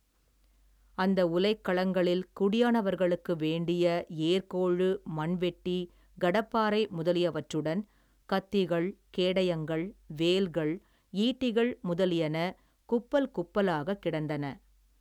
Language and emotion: Tamil, neutral